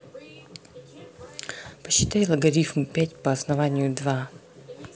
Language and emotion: Russian, neutral